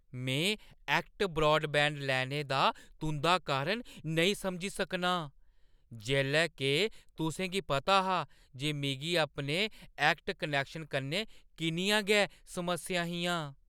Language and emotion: Dogri, surprised